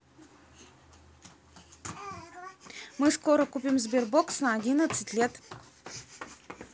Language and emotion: Russian, neutral